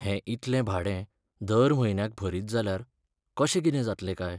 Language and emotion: Goan Konkani, sad